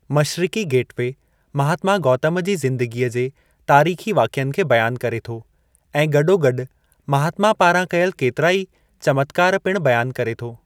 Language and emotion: Sindhi, neutral